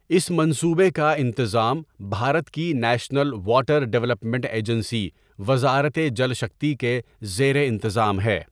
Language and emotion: Urdu, neutral